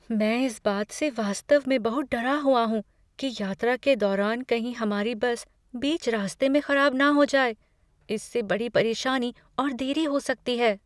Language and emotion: Hindi, fearful